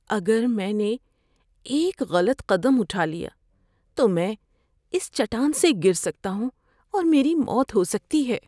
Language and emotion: Urdu, fearful